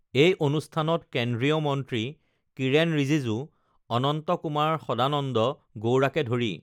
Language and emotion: Assamese, neutral